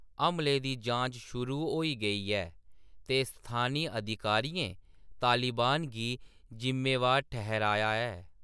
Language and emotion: Dogri, neutral